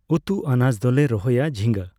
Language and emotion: Santali, neutral